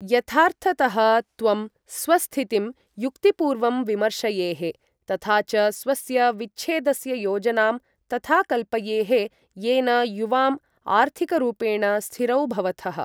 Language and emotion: Sanskrit, neutral